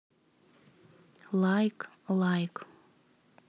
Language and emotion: Russian, neutral